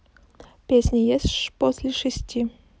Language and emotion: Russian, neutral